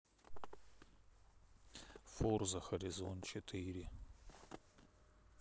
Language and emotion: Russian, neutral